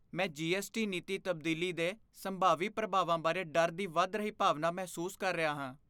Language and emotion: Punjabi, fearful